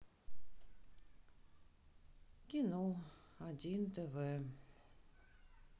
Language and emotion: Russian, sad